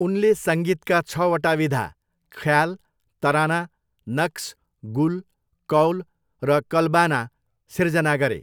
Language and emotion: Nepali, neutral